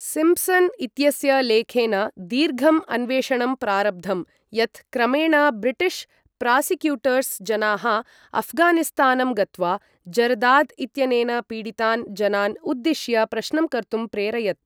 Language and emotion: Sanskrit, neutral